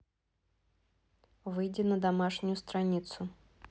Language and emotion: Russian, neutral